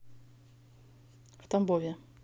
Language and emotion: Russian, neutral